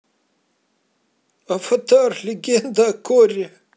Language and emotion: Russian, positive